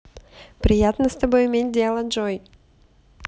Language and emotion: Russian, positive